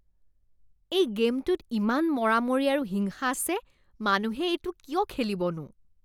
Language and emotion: Assamese, disgusted